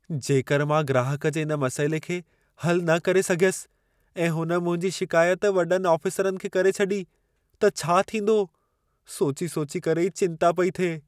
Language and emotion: Sindhi, fearful